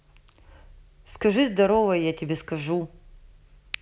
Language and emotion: Russian, neutral